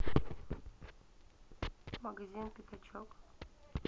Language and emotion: Russian, neutral